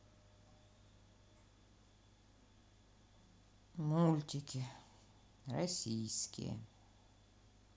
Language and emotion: Russian, sad